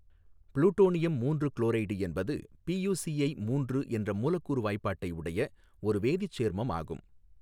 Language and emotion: Tamil, neutral